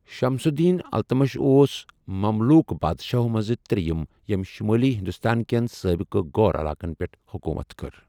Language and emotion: Kashmiri, neutral